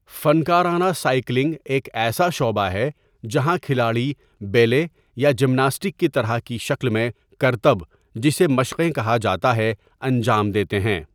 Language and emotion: Urdu, neutral